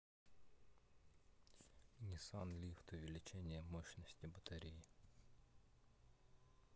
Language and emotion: Russian, neutral